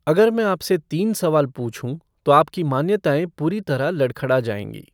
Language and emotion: Hindi, neutral